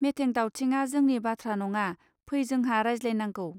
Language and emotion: Bodo, neutral